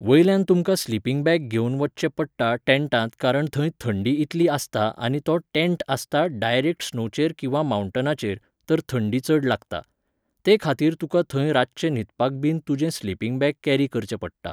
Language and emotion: Goan Konkani, neutral